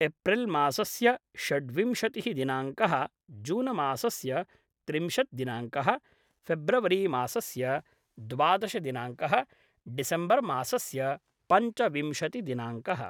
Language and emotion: Sanskrit, neutral